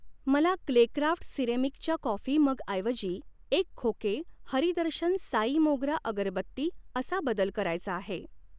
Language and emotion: Marathi, neutral